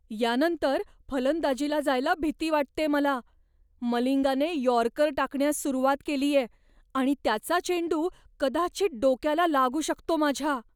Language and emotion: Marathi, fearful